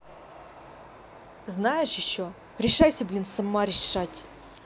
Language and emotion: Russian, angry